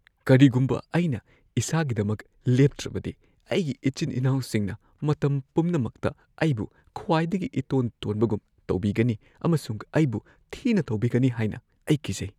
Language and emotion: Manipuri, fearful